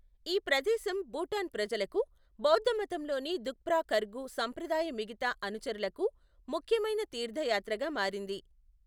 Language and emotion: Telugu, neutral